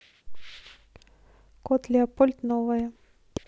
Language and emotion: Russian, neutral